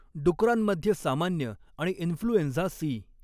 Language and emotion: Marathi, neutral